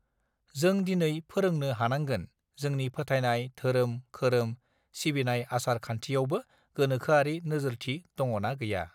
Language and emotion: Bodo, neutral